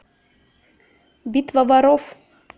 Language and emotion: Russian, neutral